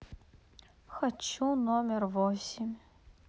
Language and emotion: Russian, neutral